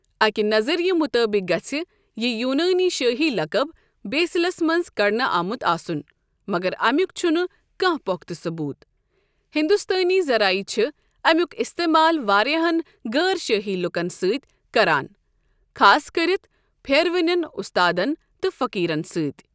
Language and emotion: Kashmiri, neutral